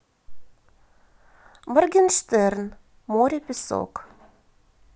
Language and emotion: Russian, positive